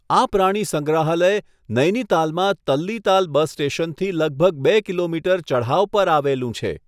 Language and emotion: Gujarati, neutral